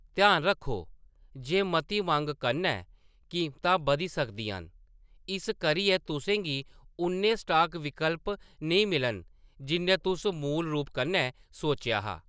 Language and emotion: Dogri, neutral